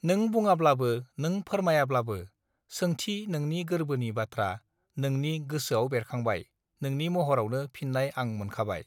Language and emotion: Bodo, neutral